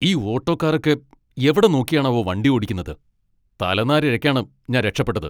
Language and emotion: Malayalam, angry